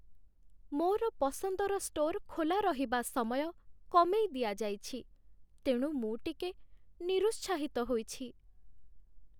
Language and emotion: Odia, sad